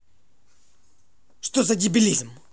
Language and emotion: Russian, angry